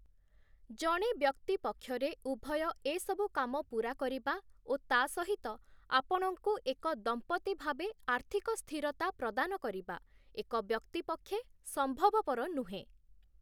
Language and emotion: Odia, neutral